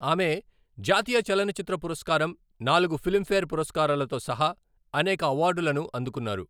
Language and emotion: Telugu, neutral